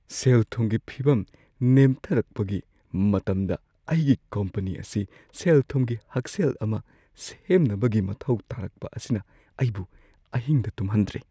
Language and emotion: Manipuri, fearful